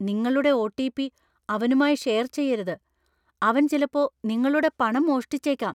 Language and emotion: Malayalam, fearful